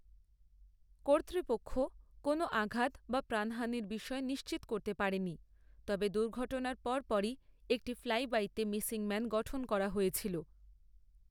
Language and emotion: Bengali, neutral